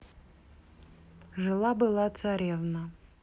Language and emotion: Russian, neutral